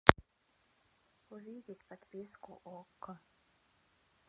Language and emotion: Russian, sad